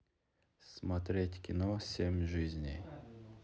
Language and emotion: Russian, neutral